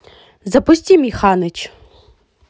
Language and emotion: Russian, positive